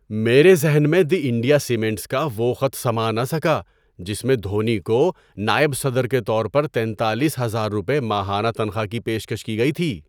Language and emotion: Urdu, surprised